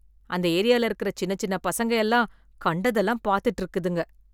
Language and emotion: Tamil, disgusted